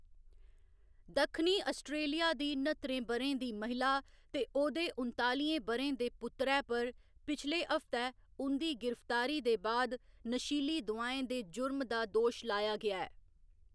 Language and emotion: Dogri, neutral